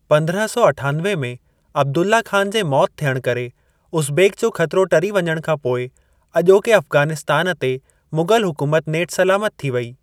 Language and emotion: Sindhi, neutral